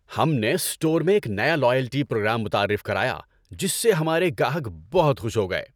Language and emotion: Urdu, happy